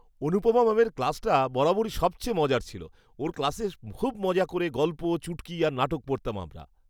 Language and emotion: Bengali, happy